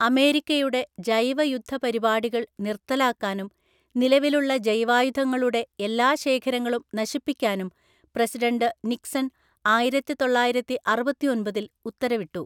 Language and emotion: Malayalam, neutral